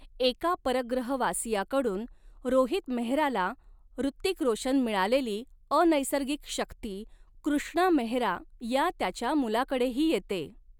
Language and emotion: Marathi, neutral